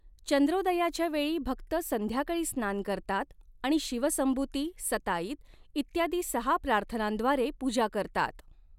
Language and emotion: Marathi, neutral